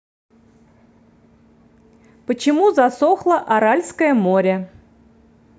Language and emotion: Russian, neutral